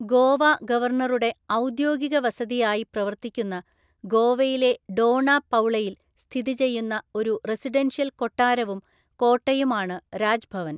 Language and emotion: Malayalam, neutral